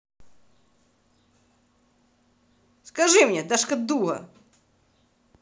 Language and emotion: Russian, angry